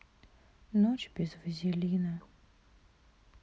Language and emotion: Russian, sad